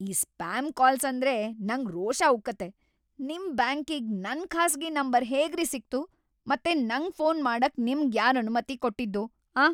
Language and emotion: Kannada, angry